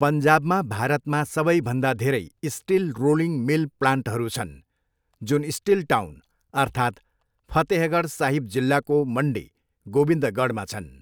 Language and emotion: Nepali, neutral